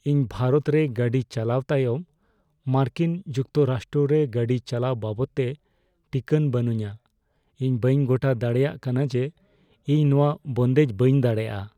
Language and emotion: Santali, fearful